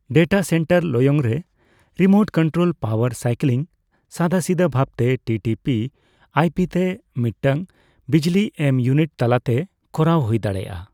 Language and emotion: Santali, neutral